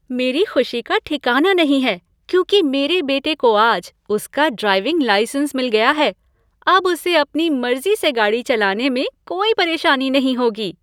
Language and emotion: Hindi, happy